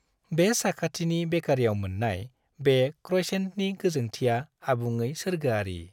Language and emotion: Bodo, happy